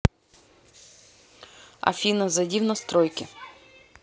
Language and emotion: Russian, neutral